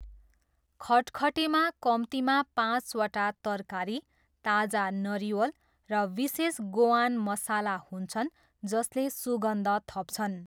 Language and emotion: Nepali, neutral